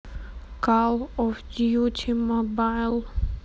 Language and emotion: Russian, neutral